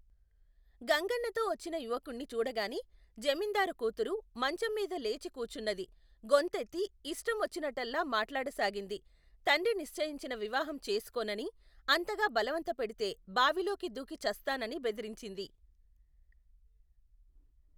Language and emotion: Telugu, neutral